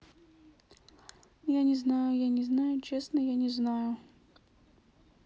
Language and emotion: Russian, sad